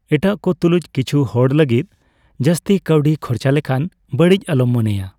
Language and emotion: Santali, neutral